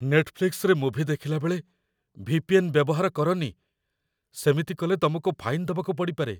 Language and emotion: Odia, fearful